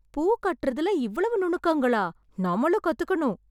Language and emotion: Tamil, surprised